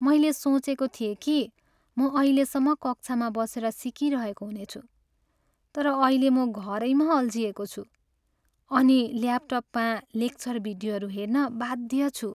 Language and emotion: Nepali, sad